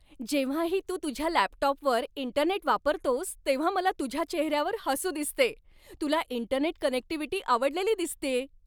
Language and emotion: Marathi, happy